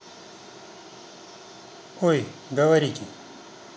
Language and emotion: Russian, neutral